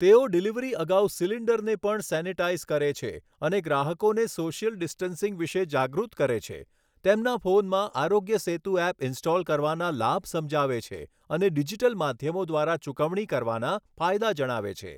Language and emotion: Gujarati, neutral